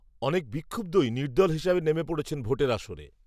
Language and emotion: Bengali, neutral